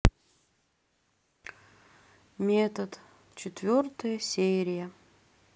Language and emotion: Russian, sad